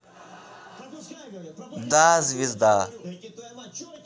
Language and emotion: Russian, neutral